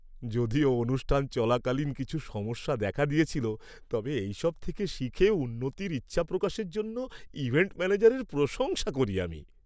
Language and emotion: Bengali, happy